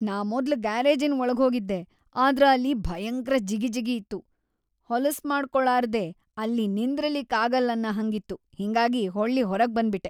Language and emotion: Kannada, disgusted